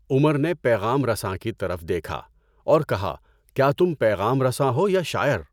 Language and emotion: Urdu, neutral